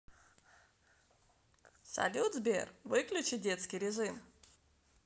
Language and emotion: Russian, positive